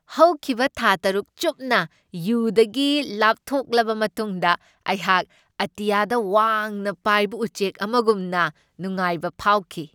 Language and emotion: Manipuri, happy